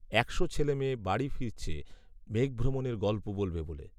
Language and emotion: Bengali, neutral